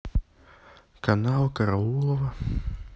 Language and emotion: Russian, sad